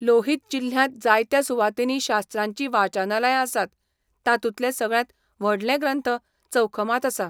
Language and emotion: Goan Konkani, neutral